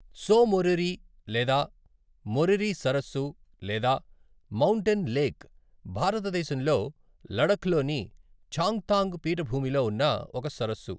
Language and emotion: Telugu, neutral